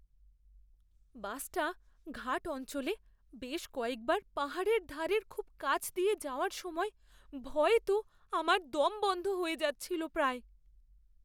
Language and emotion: Bengali, fearful